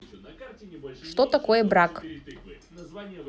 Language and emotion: Russian, neutral